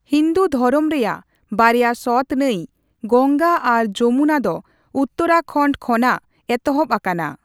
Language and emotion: Santali, neutral